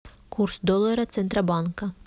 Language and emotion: Russian, neutral